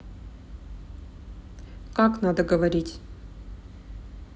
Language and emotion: Russian, neutral